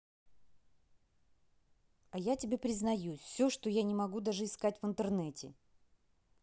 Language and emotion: Russian, angry